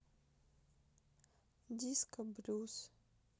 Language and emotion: Russian, sad